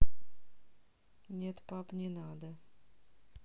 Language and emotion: Russian, neutral